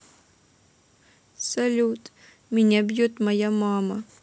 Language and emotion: Russian, sad